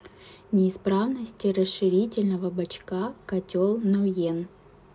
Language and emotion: Russian, neutral